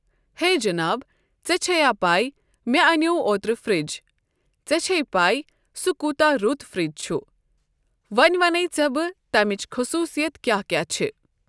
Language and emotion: Kashmiri, neutral